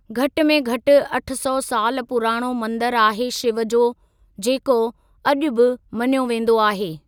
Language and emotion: Sindhi, neutral